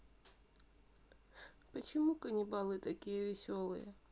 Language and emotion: Russian, sad